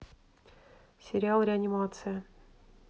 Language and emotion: Russian, neutral